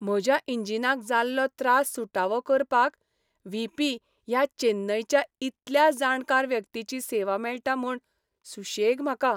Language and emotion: Goan Konkani, happy